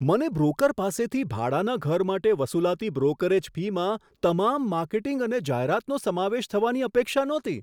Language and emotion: Gujarati, surprised